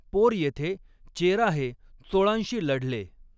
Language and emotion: Marathi, neutral